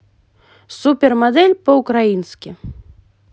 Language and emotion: Russian, positive